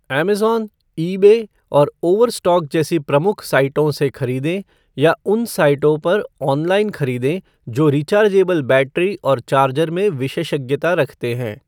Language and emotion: Hindi, neutral